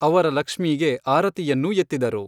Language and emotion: Kannada, neutral